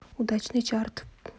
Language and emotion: Russian, neutral